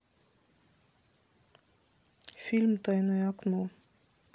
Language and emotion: Russian, sad